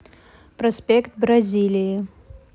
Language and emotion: Russian, neutral